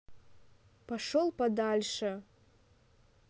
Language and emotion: Russian, neutral